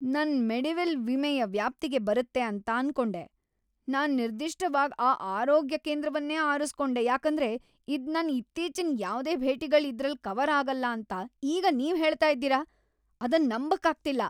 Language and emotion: Kannada, angry